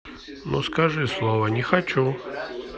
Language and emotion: Russian, neutral